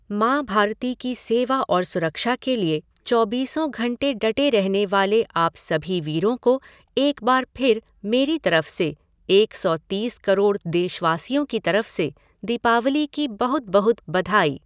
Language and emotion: Hindi, neutral